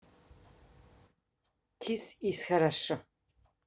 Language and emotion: Russian, neutral